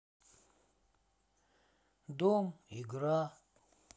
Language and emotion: Russian, sad